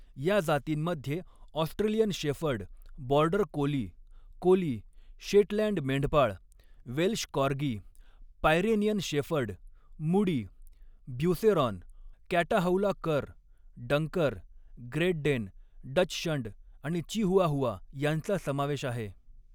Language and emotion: Marathi, neutral